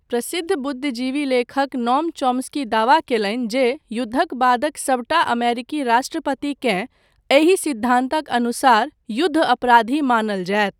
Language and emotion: Maithili, neutral